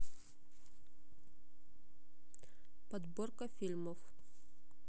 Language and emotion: Russian, neutral